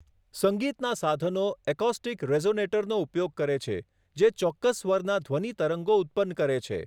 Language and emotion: Gujarati, neutral